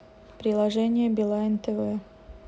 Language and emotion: Russian, neutral